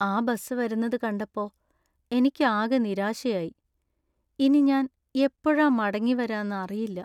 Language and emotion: Malayalam, sad